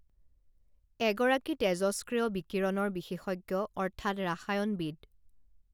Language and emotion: Assamese, neutral